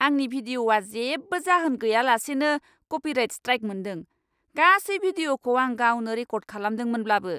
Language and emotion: Bodo, angry